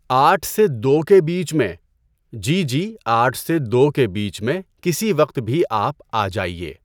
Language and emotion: Urdu, neutral